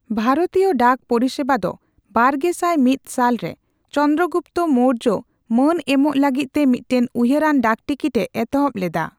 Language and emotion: Santali, neutral